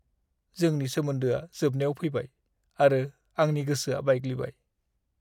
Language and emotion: Bodo, sad